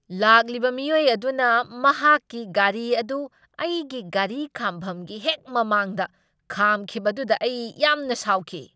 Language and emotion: Manipuri, angry